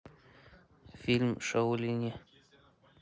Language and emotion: Russian, neutral